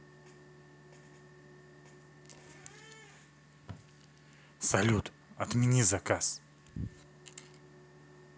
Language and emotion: Russian, neutral